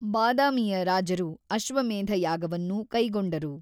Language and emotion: Kannada, neutral